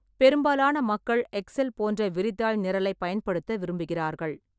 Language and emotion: Tamil, neutral